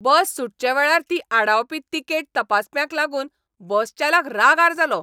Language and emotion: Goan Konkani, angry